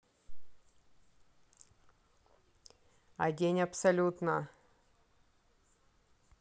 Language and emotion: Russian, neutral